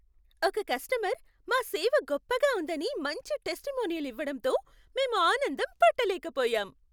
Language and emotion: Telugu, happy